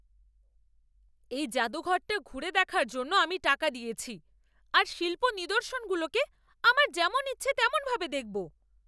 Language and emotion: Bengali, angry